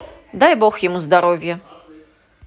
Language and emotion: Russian, positive